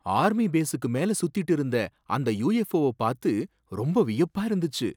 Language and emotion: Tamil, surprised